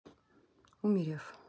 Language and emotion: Russian, neutral